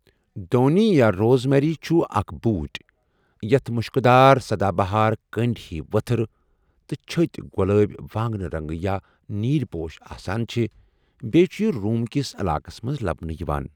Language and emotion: Kashmiri, neutral